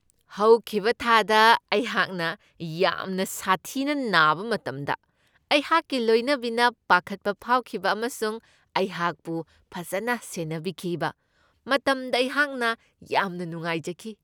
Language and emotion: Manipuri, happy